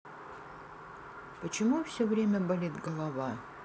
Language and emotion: Russian, sad